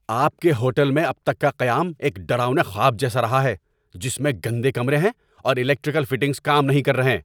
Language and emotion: Urdu, angry